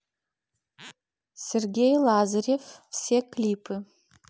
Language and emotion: Russian, neutral